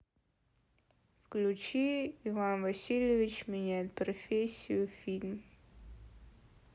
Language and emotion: Russian, sad